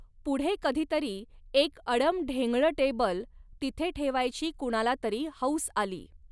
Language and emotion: Marathi, neutral